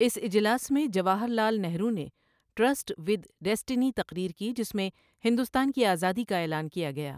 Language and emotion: Urdu, neutral